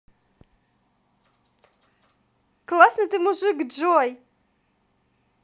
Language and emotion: Russian, positive